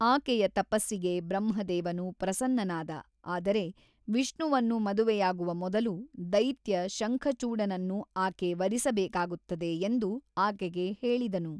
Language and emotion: Kannada, neutral